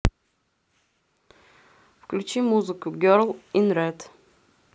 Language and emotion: Russian, neutral